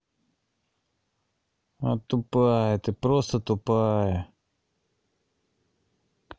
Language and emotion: Russian, angry